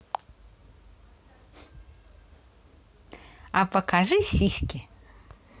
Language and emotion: Russian, positive